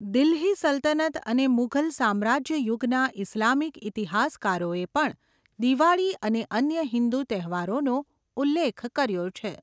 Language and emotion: Gujarati, neutral